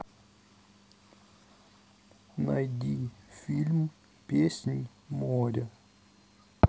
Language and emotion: Russian, sad